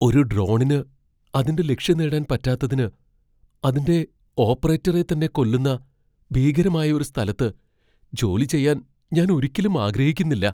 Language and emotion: Malayalam, fearful